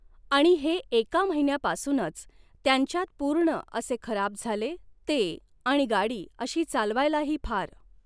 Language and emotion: Marathi, neutral